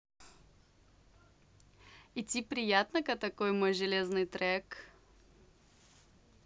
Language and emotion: Russian, positive